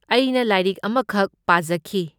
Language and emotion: Manipuri, neutral